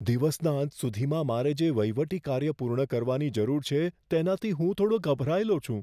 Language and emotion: Gujarati, fearful